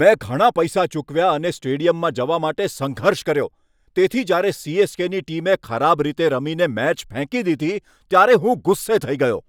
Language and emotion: Gujarati, angry